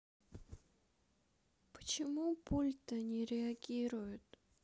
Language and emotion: Russian, sad